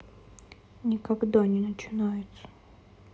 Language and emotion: Russian, sad